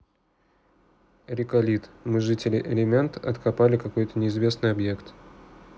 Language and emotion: Russian, neutral